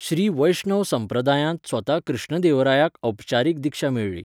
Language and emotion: Goan Konkani, neutral